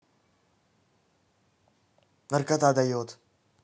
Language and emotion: Russian, neutral